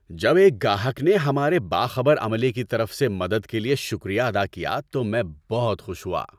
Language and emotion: Urdu, happy